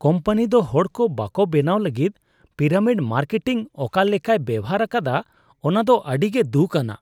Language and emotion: Santali, disgusted